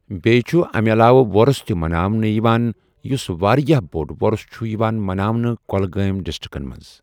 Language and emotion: Kashmiri, neutral